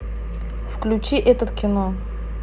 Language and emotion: Russian, neutral